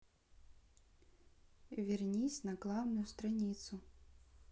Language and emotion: Russian, neutral